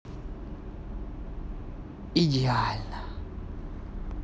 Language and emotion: Russian, positive